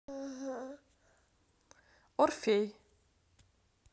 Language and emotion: Russian, neutral